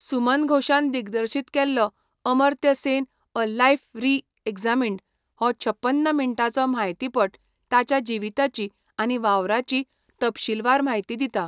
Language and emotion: Goan Konkani, neutral